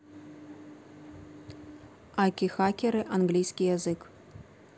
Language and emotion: Russian, neutral